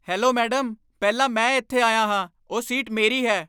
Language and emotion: Punjabi, angry